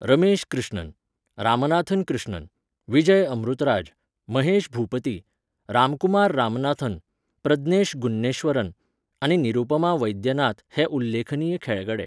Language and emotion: Goan Konkani, neutral